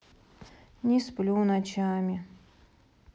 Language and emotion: Russian, sad